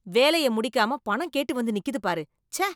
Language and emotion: Tamil, disgusted